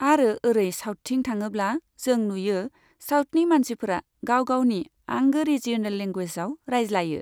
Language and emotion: Bodo, neutral